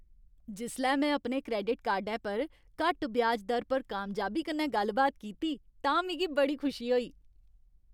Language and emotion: Dogri, happy